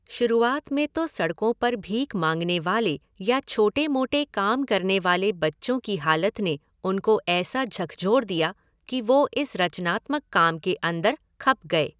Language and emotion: Hindi, neutral